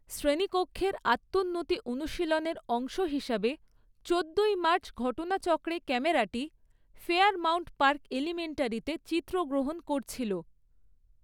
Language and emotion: Bengali, neutral